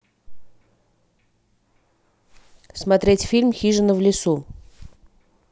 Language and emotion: Russian, neutral